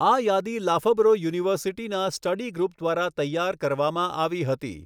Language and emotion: Gujarati, neutral